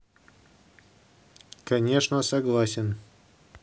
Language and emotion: Russian, neutral